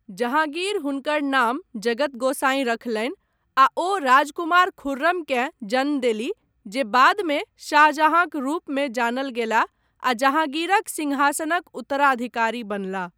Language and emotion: Maithili, neutral